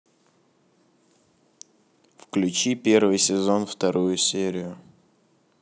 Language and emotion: Russian, neutral